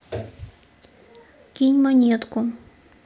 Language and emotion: Russian, neutral